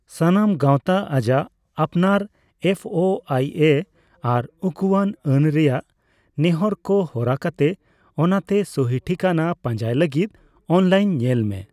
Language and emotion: Santali, neutral